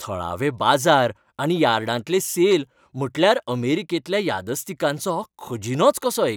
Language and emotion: Goan Konkani, happy